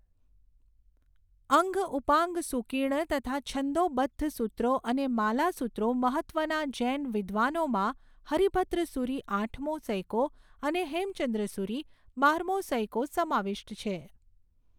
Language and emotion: Gujarati, neutral